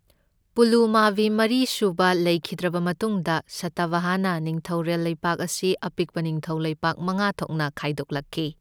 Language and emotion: Manipuri, neutral